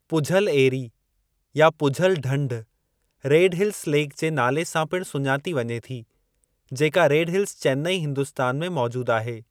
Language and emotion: Sindhi, neutral